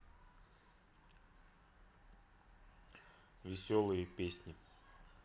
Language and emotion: Russian, neutral